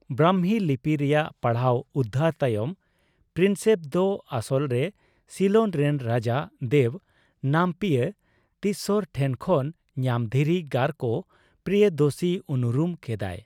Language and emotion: Santali, neutral